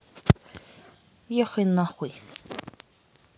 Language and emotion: Russian, angry